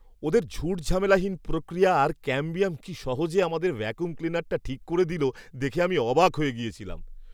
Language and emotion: Bengali, surprised